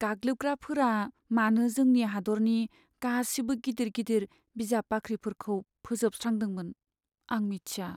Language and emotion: Bodo, sad